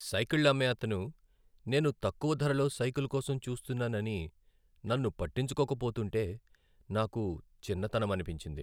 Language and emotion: Telugu, sad